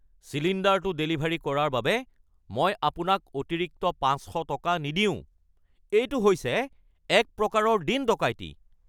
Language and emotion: Assamese, angry